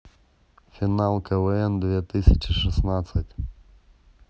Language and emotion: Russian, neutral